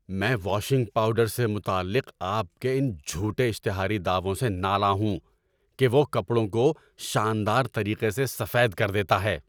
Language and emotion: Urdu, angry